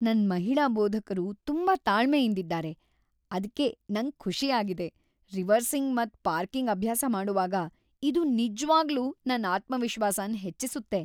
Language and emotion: Kannada, happy